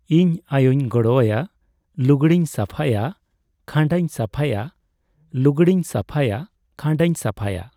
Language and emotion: Santali, neutral